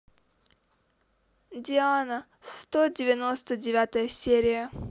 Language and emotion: Russian, neutral